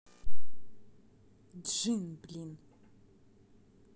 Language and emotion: Russian, angry